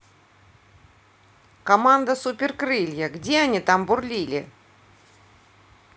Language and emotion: Russian, neutral